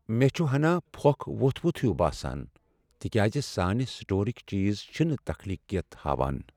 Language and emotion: Kashmiri, sad